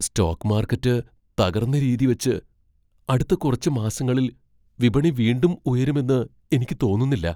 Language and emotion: Malayalam, fearful